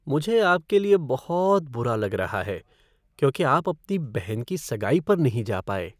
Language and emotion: Hindi, sad